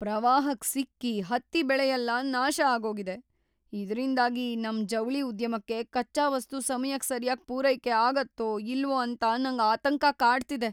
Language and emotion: Kannada, fearful